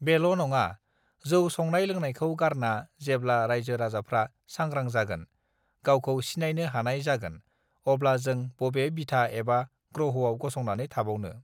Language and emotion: Bodo, neutral